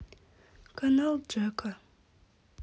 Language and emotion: Russian, sad